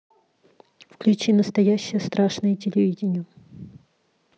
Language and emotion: Russian, neutral